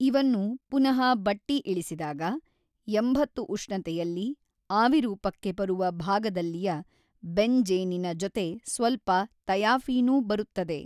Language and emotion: Kannada, neutral